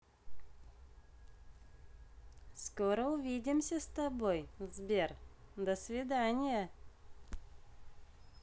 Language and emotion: Russian, positive